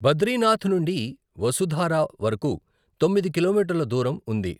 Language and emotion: Telugu, neutral